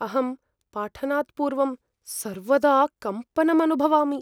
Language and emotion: Sanskrit, fearful